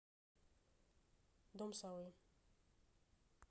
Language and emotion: Russian, neutral